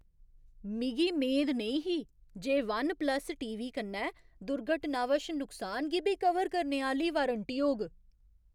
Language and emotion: Dogri, surprised